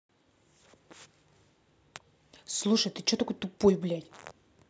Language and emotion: Russian, angry